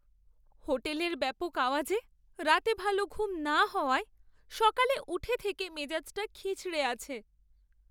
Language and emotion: Bengali, sad